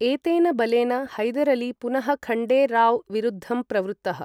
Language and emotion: Sanskrit, neutral